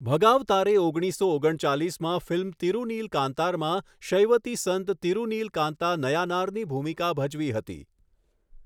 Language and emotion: Gujarati, neutral